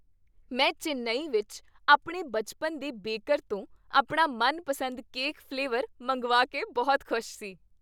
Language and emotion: Punjabi, happy